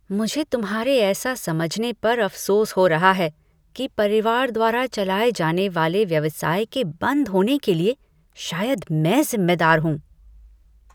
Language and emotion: Hindi, disgusted